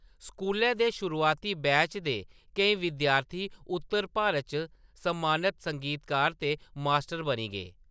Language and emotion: Dogri, neutral